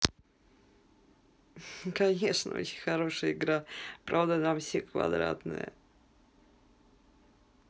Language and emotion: Russian, positive